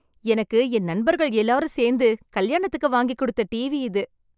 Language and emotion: Tamil, happy